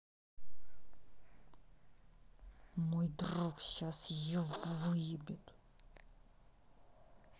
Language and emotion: Russian, angry